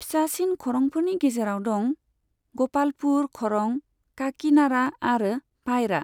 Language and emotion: Bodo, neutral